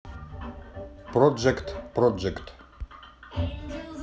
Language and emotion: Russian, neutral